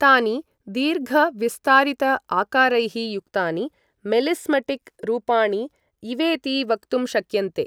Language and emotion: Sanskrit, neutral